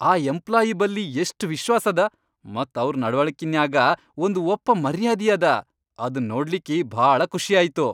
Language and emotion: Kannada, happy